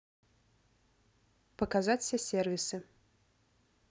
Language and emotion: Russian, neutral